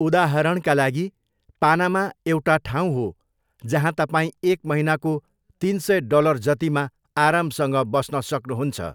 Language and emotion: Nepali, neutral